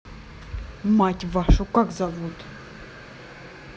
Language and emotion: Russian, angry